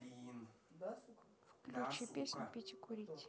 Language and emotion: Russian, neutral